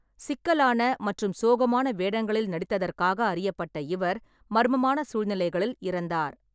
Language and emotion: Tamil, neutral